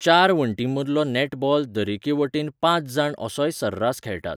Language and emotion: Goan Konkani, neutral